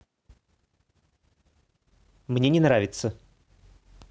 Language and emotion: Russian, neutral